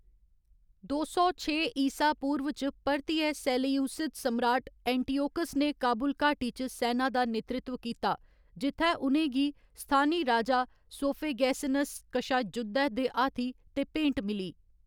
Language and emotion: Dogri, neutral